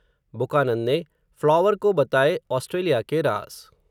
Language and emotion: Hindi, neutral